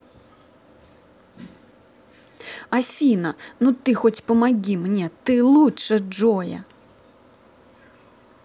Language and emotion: Russian, angry